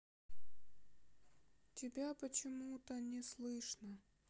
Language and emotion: Russian, sad